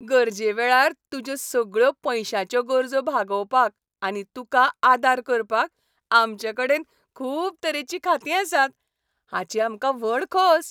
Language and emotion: Goan Konkani, happy